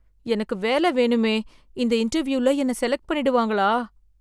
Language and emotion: Tamil, fearful